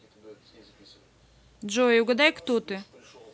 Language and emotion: Russian, neutral